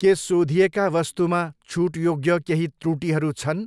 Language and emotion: Nepali, neutral